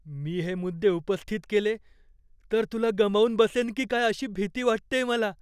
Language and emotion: Marathi, fearful